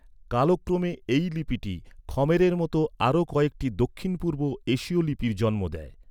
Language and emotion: Bengali, neutral